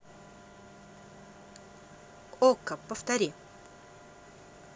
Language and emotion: Russian, neutral